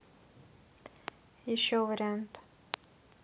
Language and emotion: Russian, neutral